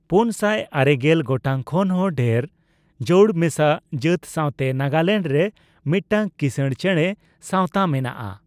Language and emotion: Santali, neutral